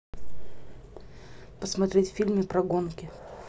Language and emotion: Russian, neutral